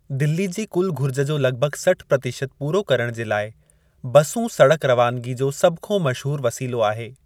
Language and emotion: Sindhi, neutral